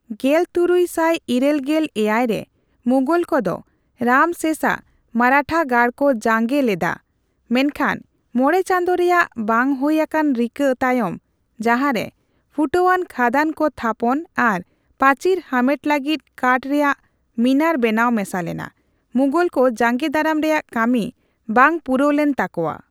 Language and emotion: Santali, neutral